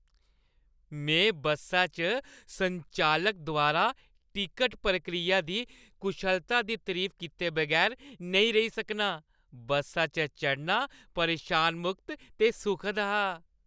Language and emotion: Dogri, happy